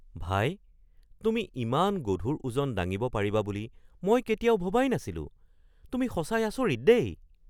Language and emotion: Assamese, surprised